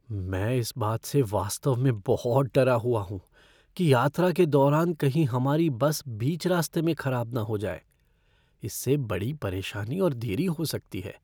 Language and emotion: Hindi, fearful